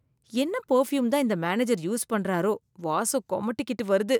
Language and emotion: Tamil, disgusted